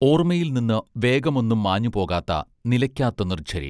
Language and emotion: Malayalam, neutral